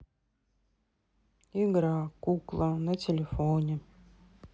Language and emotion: Russian, sad